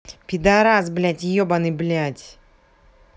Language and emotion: Russian, angry